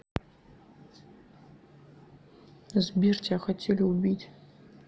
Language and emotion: Russian, sad